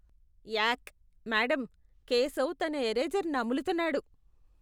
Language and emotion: Telugu, disgusted